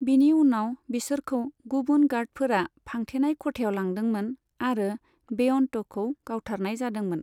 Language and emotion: Bodo, neutral